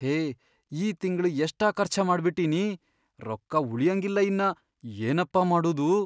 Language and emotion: Kannada, fearful